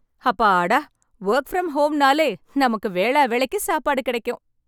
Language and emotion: Tamil, happy